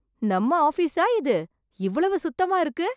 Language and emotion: Tamil, surprised